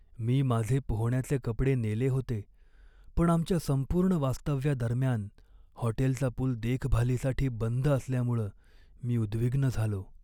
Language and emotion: Marathi, sad